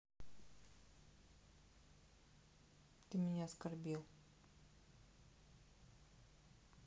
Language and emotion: Russian, sad